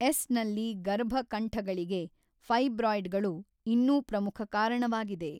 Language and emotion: Kannada, neutral